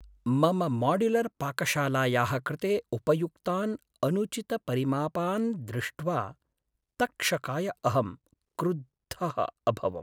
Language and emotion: Sanskrit, sad